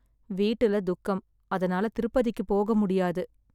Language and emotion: Tamil, sad